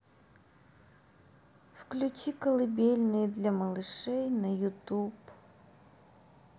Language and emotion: Russian, sad